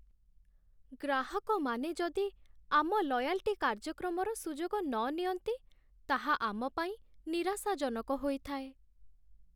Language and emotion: Odia, sad